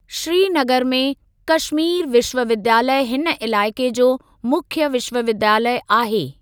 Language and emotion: Sindhi, neutral